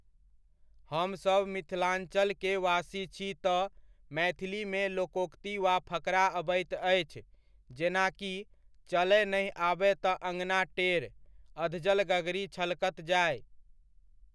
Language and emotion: Maithili, neutral